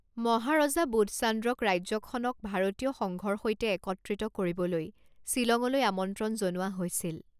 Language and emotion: Assamese, neutral